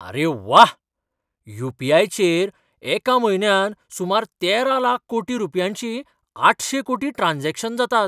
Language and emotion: Goan Konkani, surprised